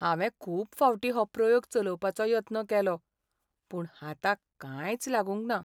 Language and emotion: Goan Konkani, sad